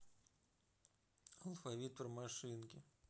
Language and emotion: Russian, neutral